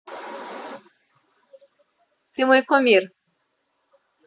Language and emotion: Russian, positive